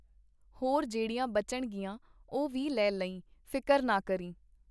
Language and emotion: Punjabi, neutral